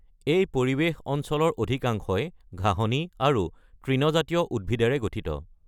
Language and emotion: Assamese, neutral